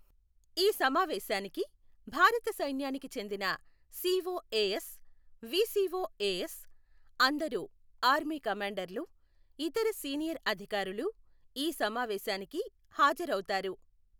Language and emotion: Telugu, neutral